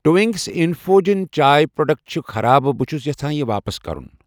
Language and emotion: Kashmiri, neutral